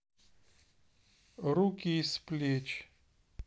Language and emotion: Russian, neutral